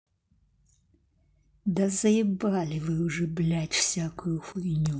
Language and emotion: Russian, angry